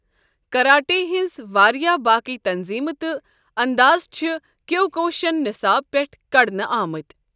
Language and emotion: Kashmiri, neutral